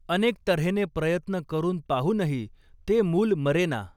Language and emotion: Marathi, neutral